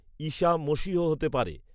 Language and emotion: Bengali, neutral